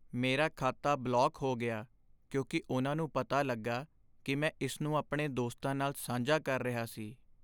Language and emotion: Punjabi, sad